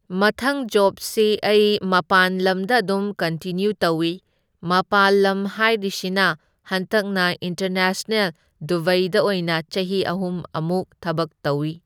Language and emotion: Manipuri, neutral